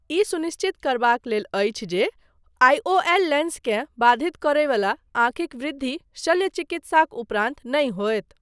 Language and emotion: Maithili, neutral